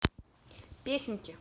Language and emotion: Russian, neutral